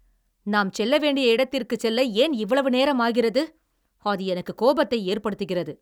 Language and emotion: Tamil, angry